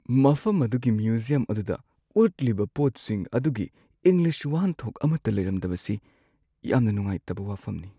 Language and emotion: Manipuri, sad